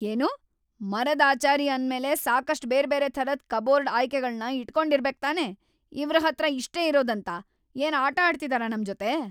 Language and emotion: Kannada, angry